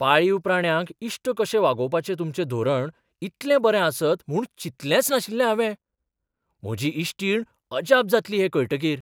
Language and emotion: Goan Konkani, surprised